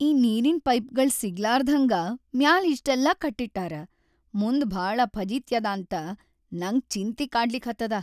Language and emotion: Kannada, sad